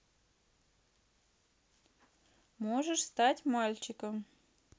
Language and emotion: Russian, neutral